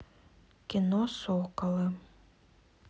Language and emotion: Russian, neutral